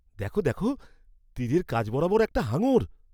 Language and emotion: Bengali, surprised